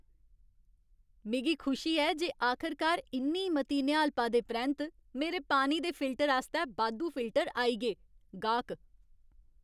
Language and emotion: Dogri, happy